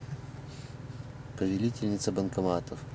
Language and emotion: Russian, neutral